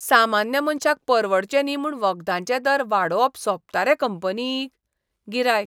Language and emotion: Goan Konkani, disgusted